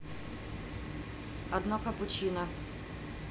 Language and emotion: Russian, neutral